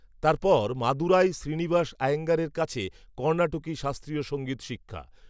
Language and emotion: Bengali, neutral